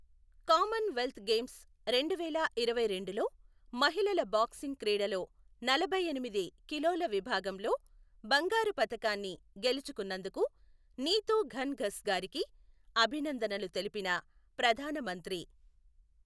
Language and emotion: Telugu, neutral